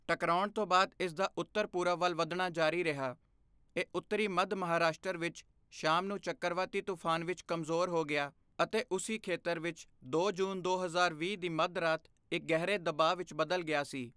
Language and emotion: Punjabi, neutral